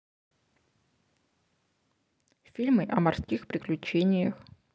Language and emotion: Russian, neutral